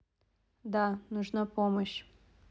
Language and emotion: Russian, neutral